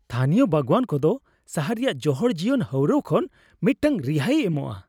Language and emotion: Santali, happy